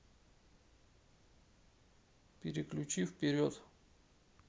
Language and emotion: Russian, neutral